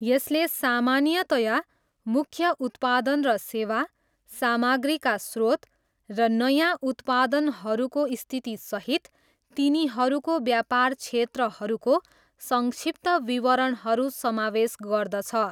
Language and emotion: Nepali, neutral